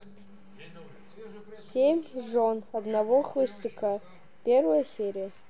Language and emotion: Russian, neutral